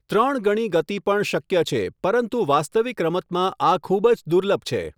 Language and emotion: Gujarati, neutral